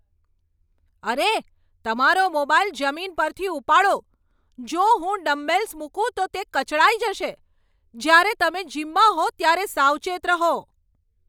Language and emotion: Gujarati, angry